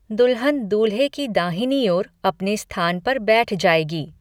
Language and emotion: Hindi, neutral